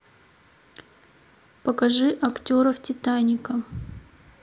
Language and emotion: Russian, neutral